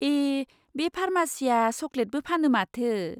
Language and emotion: Bodo, surprised